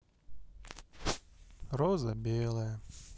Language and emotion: Russian, sad